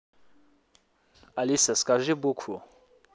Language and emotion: Russian, neutral